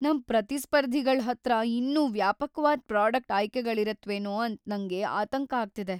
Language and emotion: Kannada, fearful